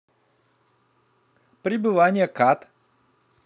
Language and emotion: Russian, neutral